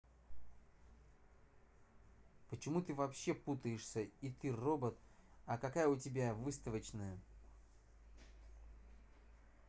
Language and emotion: Russian, angry